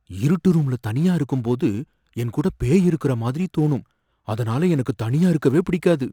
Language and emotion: Tamil, fearful